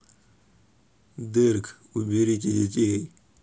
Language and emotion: Russian, neutral